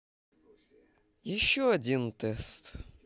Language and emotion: Russian, sad